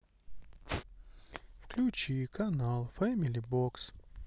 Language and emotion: Russian, sad